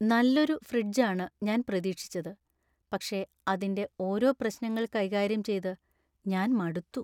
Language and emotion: Malayalam, sad